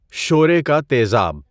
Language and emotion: Urdu, neutral